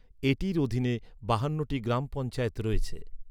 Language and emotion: Bengali, neutral